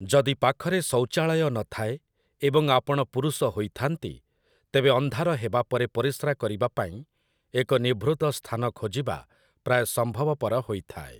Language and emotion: Odia, neutral